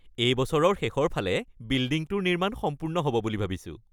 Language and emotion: Assamese, happy